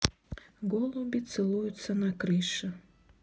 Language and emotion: Russian, neutral